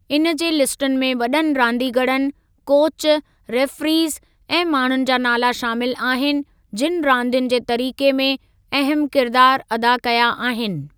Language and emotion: Sindhi, neutral